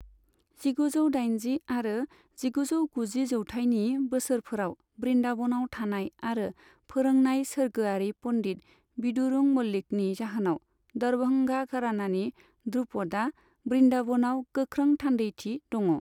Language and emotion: Bodo, neutral